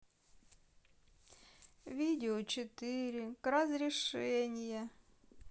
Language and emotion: Russian, sad